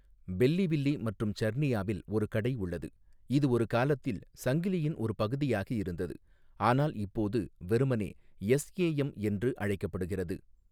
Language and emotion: Tamil, neutral